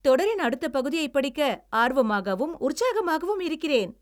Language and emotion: Tamil, happy